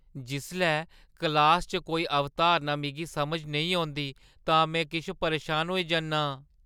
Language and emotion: Dogri, fearful